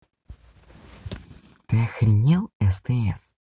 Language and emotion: Russian, angry